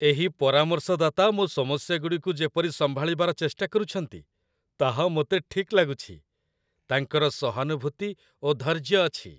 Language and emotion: Odia, happy